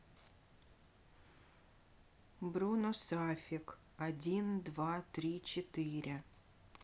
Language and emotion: Russian, neutral